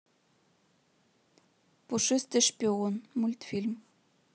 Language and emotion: Russian, neutral